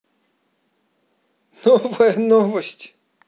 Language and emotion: Russian, positive